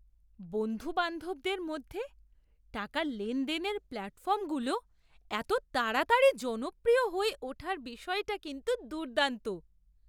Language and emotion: Bengali, surprised